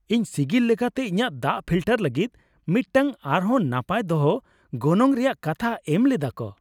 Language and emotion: Santali, happy